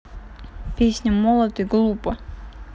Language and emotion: Russian, neutral